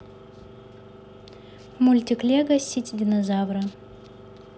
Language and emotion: Russian, neutral